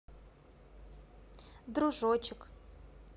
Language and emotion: Russian, neutral